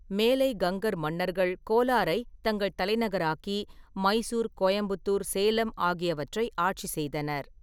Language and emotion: Tamil, neutral